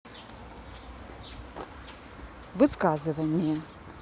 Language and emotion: Russian, neutral